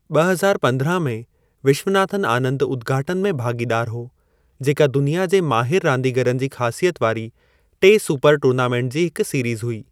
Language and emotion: Sindhi, neutral